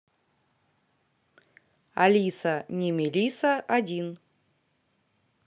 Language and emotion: Russian, neutral